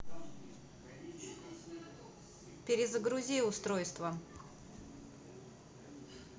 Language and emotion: Russian, neutral